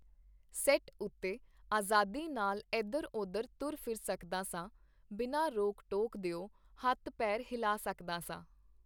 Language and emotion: Punjabi, neutral